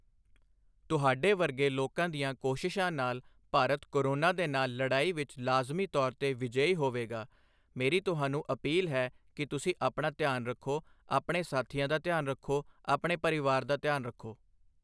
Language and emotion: Punjabi, neutral